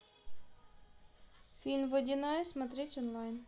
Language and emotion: Russian, neutral